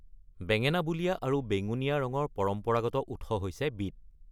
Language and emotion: Assamese, neutral